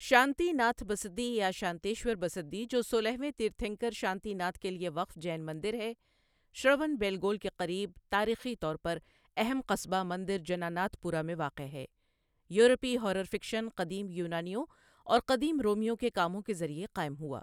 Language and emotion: Urdu, neutral